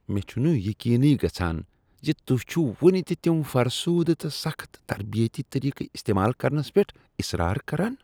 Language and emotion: Kashmiri, disgusted